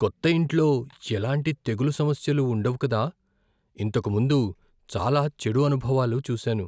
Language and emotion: Telugu, fearful